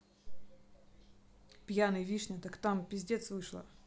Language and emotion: Russian, angry